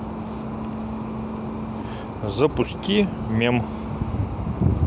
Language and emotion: Russian, neutral